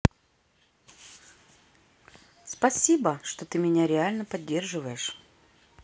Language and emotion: Russian, positive